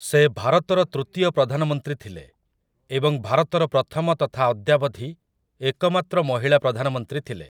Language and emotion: Odia, neutral